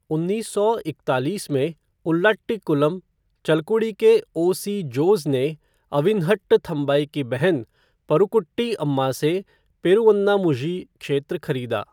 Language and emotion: Hindi, neutral